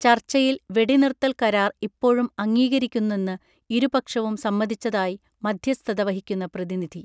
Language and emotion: Malayalam, neutral